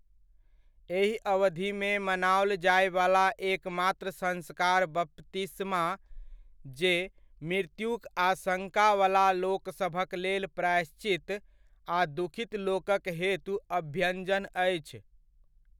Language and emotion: Maithili, neutral